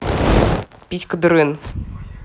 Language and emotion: Russian, neutral